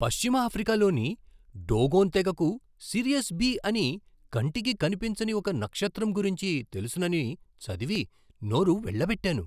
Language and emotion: Telugu, surprised